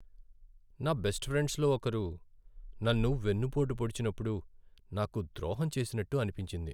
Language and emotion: Telugu, sad